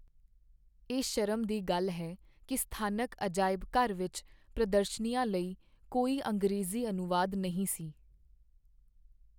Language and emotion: Punjabi, sad